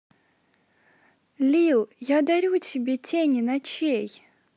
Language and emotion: Russian, positive